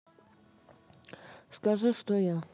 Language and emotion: Russian, neutral